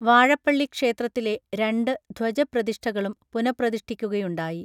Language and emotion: Malayalam, neutral